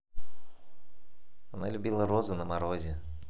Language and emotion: Russian, neutral